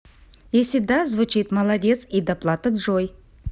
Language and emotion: Russian, positive